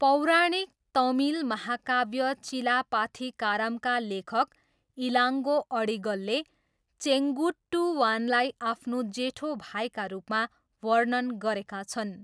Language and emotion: Nepali, neutral